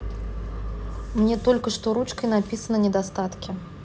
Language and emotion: Russian, neutral